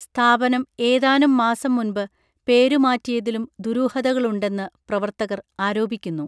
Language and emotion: Malayalam, neutral